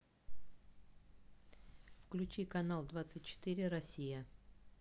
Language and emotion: Russian, neutral